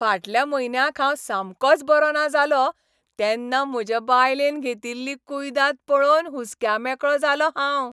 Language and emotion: Goan Konkani, happy